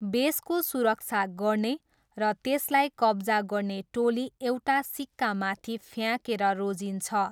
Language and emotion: Nepali, neutral